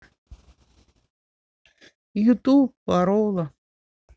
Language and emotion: Russian, sad